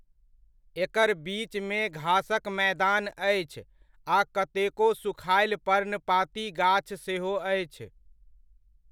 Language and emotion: Maithili, neutral